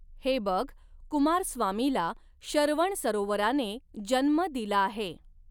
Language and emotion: Marathi, neutral